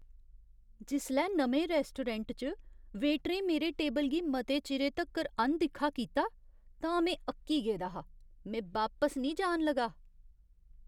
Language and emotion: Dogri, disgusted